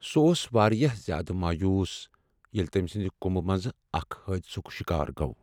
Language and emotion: Kashmiri, sad